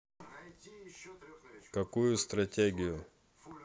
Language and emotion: Russian, neutral